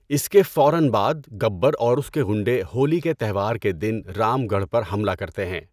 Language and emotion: Urdu, neutral